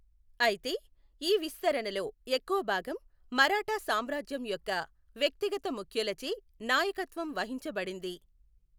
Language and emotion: Telugu, neutral